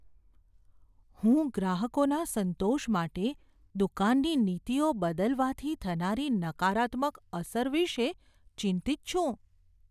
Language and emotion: Gujarati, fearful